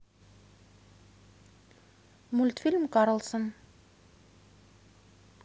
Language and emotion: Russian, neutral